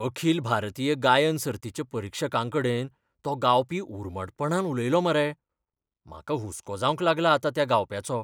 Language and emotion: Goan Konkani, fearful